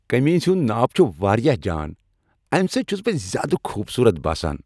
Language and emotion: Kashmiri, happy